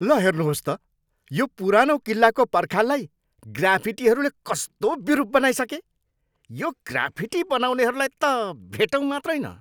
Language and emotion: Nepali, angry